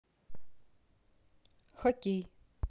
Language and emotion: Russian, neutral